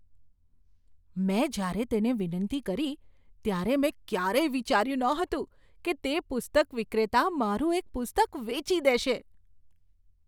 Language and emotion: Gujarati, surprised